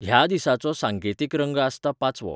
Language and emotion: Goan Konkani, neutral